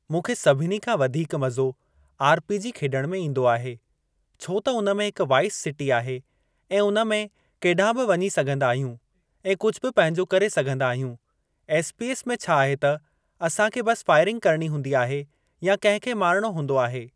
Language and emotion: Sindhi, neutral